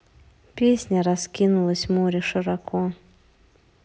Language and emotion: Russian, neutral